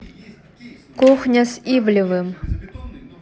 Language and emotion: Russian, neutral